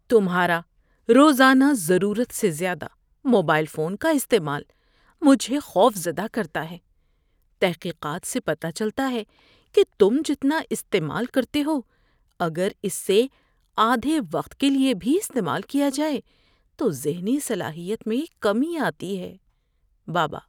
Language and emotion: Urdu, fearful